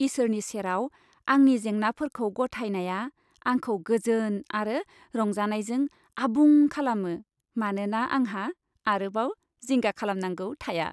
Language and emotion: Bodo, happy